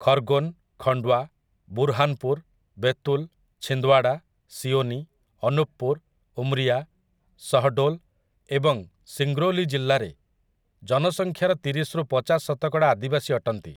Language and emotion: Odia, neutral